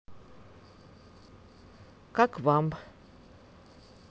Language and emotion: Russian, neutral